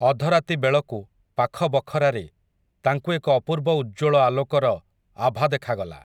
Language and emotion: Odia, neutral